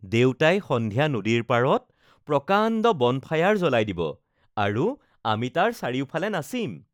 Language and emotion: Assamese, happy